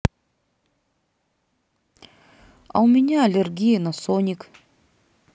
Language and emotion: Russian, sad